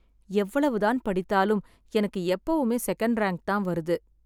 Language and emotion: Tamil, sad